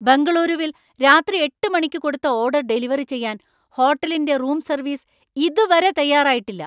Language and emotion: Malayalam, angry